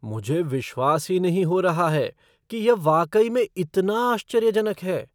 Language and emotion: Hindi, surprised